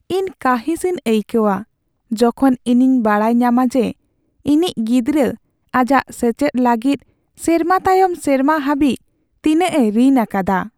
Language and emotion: Santali, sad